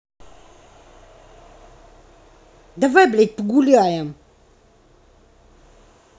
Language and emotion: Russian, angry